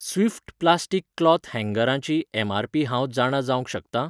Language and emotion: Goan Konkani, neutral